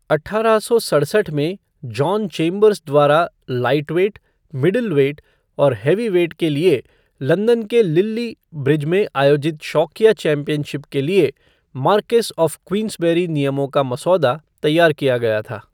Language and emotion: Hindi, neutral